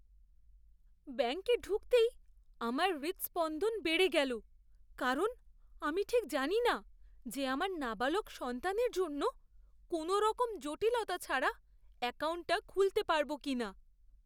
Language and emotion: Bengali, fearful